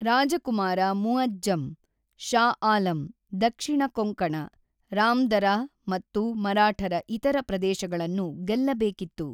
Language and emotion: Kannada, neutral